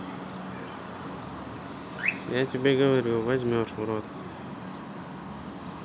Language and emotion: Russian, neutral